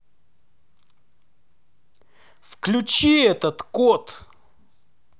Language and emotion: Russian, angry